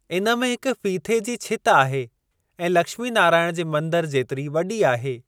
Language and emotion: Sindhi, neutral